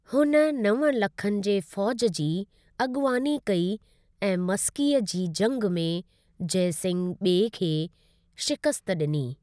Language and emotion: Sindhi, neutral